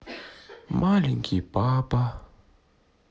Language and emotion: Russian, sad